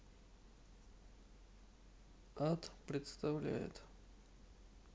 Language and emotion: Russian, neutral